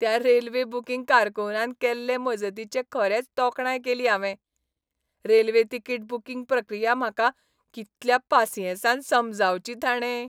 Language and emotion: Goan Konkani, happy